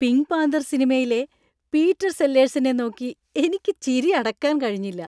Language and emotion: Malayalam, happy